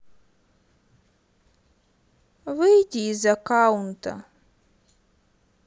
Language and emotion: Russian, sad